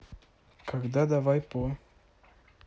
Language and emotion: Russian, neutral